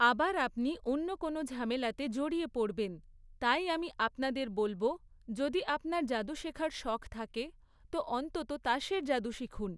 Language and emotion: Bengali, neutral